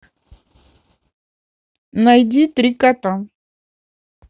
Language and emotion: Russian, neutral